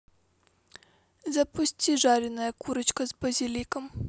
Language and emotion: Russian, neutral